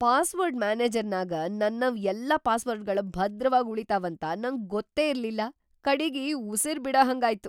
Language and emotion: Kannada, surprised